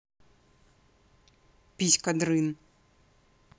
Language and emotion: Russian, neutral